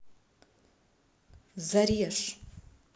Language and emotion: Russian, angry